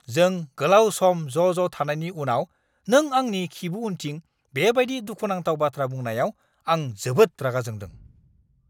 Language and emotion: Bodo, angry